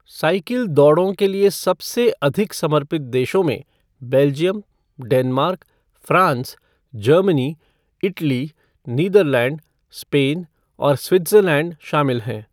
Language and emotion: Hindi, neutral